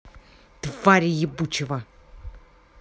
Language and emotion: Russian, angry